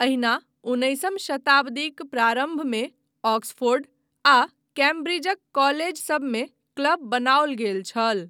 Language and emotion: Maithili, neutral